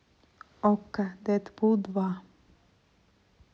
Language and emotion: Russian, neutral